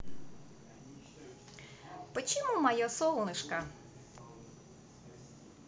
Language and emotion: Russian, positive